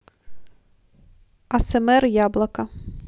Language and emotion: Russian, neutral